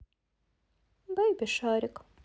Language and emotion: Russian, neutral